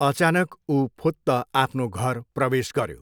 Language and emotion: Nepali, neutral